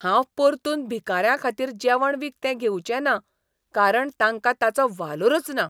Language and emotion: Goan Konkani, disgusted